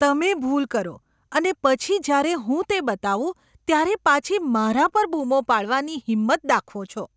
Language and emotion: Gujarati, disgusted